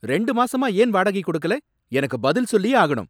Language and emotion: Tamil, angry